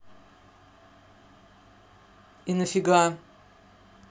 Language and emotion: Russian, angry